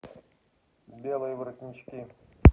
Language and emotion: Russian, neutral